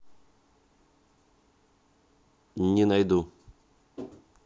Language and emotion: Russian, neutral